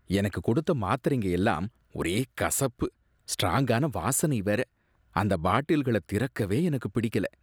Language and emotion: Tamil, disgusted